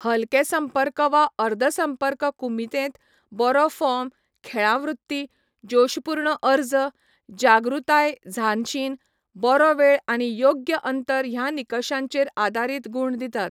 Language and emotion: Goan Konkani, neutral